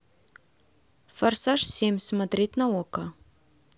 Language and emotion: Russian, neutral